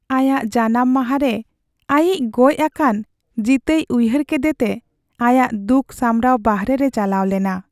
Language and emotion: Santali, sad